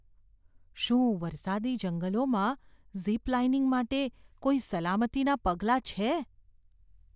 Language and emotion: Gujarati, fearful